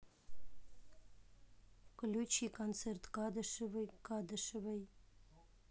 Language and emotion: Russian, neutral